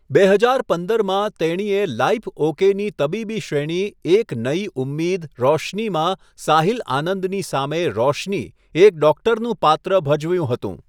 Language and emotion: Gujarati, neutral